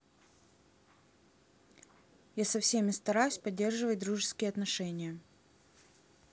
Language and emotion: Russian, neutral